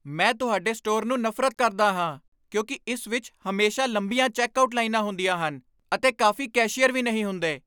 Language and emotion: Punjabi, angry